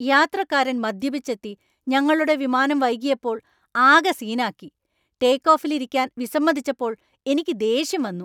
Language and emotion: Malayalam, angry